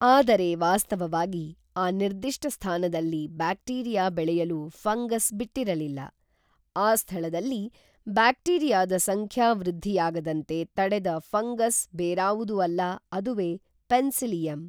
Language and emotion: Kannada, neutral